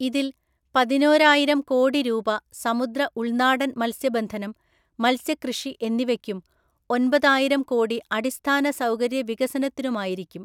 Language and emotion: Malayalam, neutral